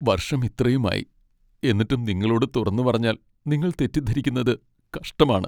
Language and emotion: Malayalam, sad